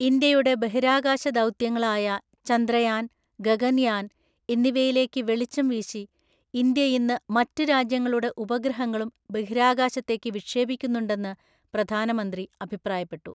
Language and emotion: Malayalam, neutral